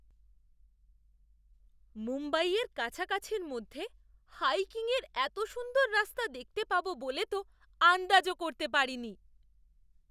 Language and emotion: Bengali, surprised